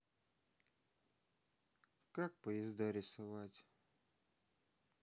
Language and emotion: Russian, sad